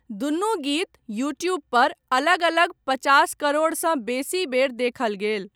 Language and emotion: Maithili, neutral